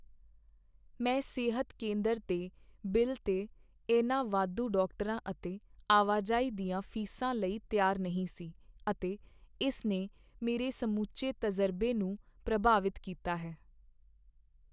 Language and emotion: Punjabi, sad